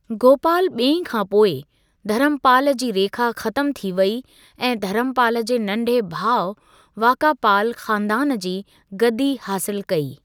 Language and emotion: Sindhi, neutral